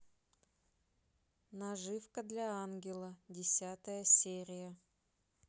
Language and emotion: Russian, neutral